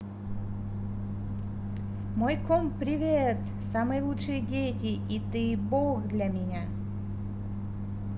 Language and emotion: Russian, positive